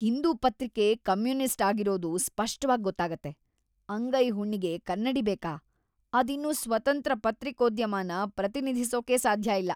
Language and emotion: Kannada, disgusted